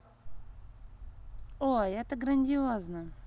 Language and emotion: Russian, positive